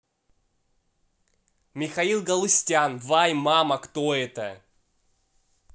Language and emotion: Russian, neutral